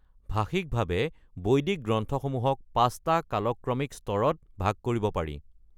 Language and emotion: Assamese, neutral